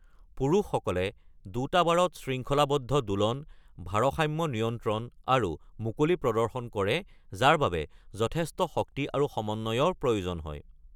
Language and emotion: Assamese, neutral